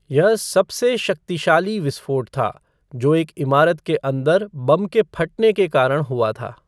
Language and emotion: Hindi, neutral